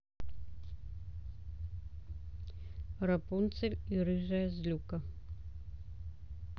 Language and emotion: Russian, neutral